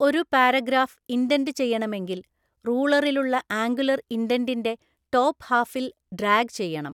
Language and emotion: Malayalam, neutral